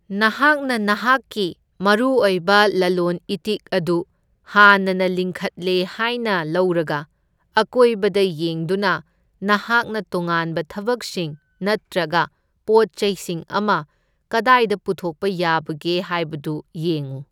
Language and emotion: Manipuri, neutral